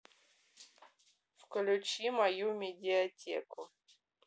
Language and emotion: Russian, neutral